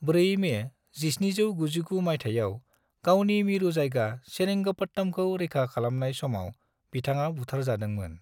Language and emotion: Bodo, neutral